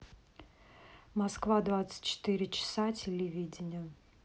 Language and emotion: Russian, neutral